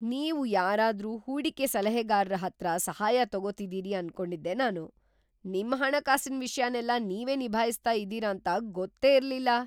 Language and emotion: Kannada, surprised